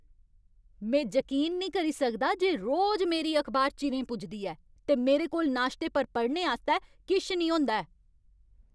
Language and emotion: Dogri, angry